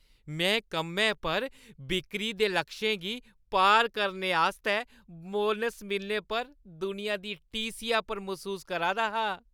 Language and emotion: Dogri, happy